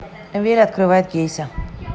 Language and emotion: Russian, neutral